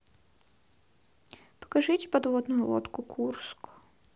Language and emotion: Russian, sad